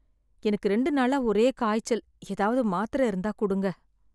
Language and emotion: Tamil, sad